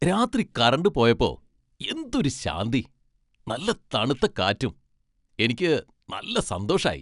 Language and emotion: Malayalam, happy